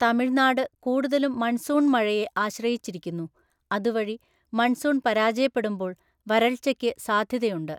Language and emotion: Malayalam, neutral